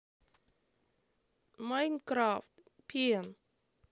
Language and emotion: Russian, sad